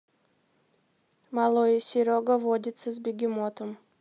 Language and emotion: Russian, neutral